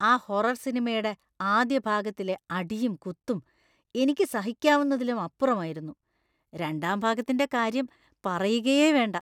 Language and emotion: Malayalam, disgusted